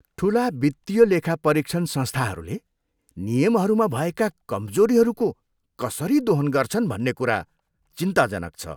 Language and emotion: Nepali, disgusted